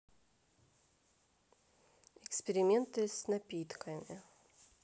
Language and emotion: Russian, neutral